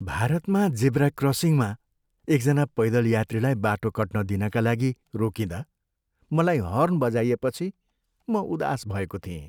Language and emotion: Nepali, sad